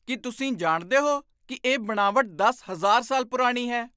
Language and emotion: Punjabi, surprised